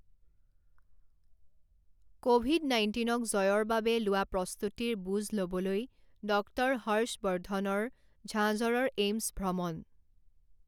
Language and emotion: Assamese, neutral